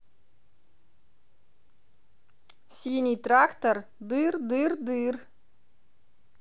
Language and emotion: Russian, positive